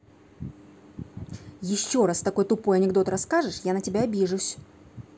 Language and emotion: Russian, angry